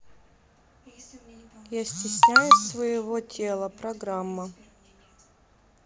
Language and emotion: Russian, neutral